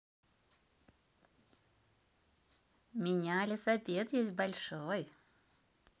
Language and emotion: Russian, positive